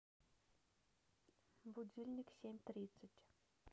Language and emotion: Russian, neutral